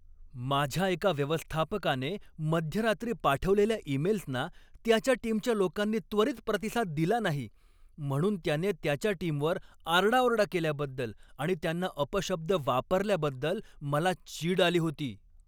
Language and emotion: Marathi, angry